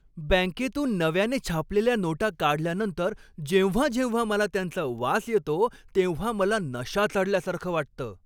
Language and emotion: Marathi, happy